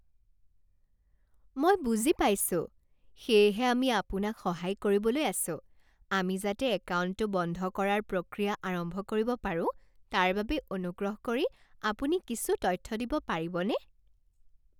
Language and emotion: Assamese, happy